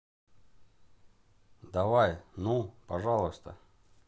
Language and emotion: Russian, neutral